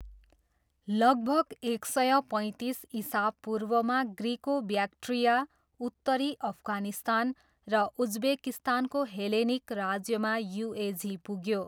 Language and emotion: Nepali, neutral